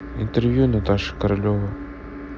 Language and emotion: Russian, neutral